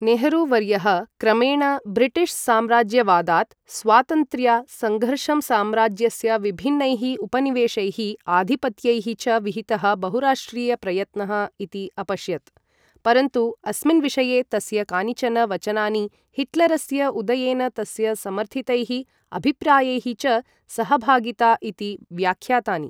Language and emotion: Sanskrit, neutral